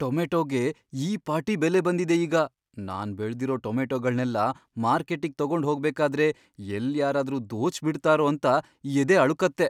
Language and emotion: Kannada, fearful